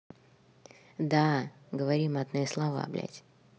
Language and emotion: Russian, neutral